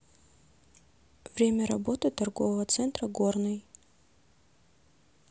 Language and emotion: Russian, neutral